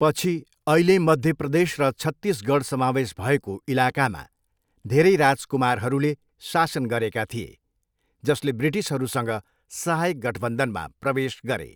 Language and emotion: Nepali, neutral